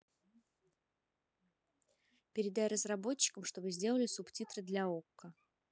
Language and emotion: Russian, neutral